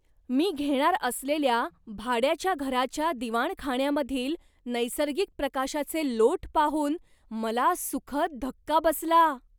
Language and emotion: Marathi, surprised